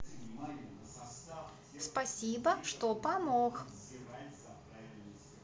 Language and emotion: Russian, positive